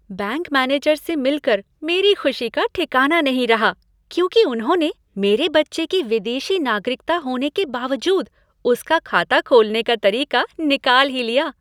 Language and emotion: Hindi, happy